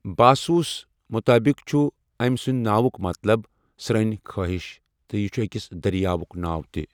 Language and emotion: Kashmiri, neutral